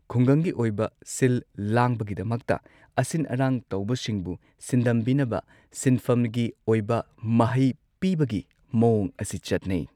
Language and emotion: Manipuri, neutral